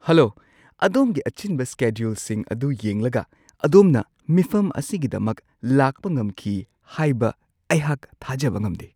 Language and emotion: Manipuri, surprised